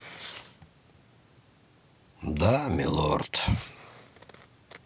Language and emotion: Russian, sad